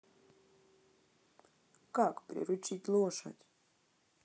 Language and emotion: Russian, sad